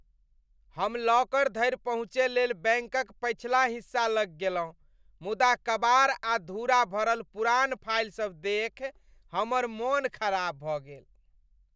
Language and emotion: Maithili, disgusted